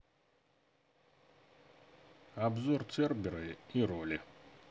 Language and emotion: Russian, neutral